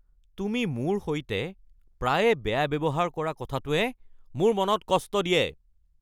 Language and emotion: Assamese, angry